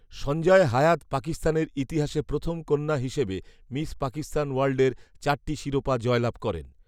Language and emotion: Bengali, neutral